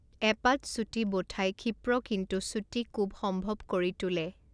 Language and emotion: Assamese, neutral